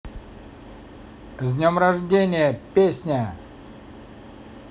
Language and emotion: Russian, positive